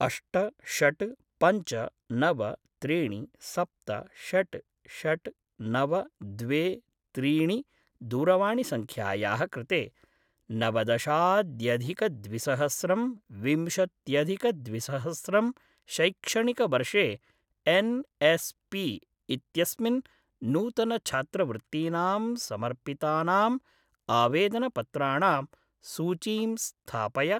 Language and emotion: Sanskrit, neutral